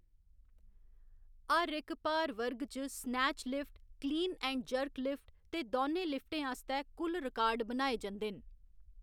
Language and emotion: Dogri, neutral